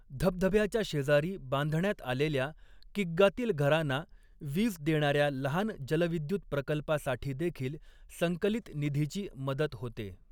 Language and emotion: Marathi, neutral